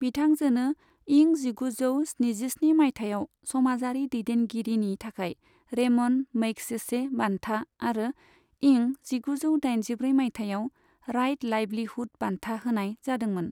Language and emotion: Bodo, neutral